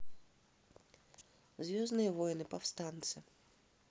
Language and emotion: Russian, neutral